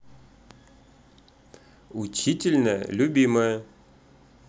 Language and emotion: Russian, positive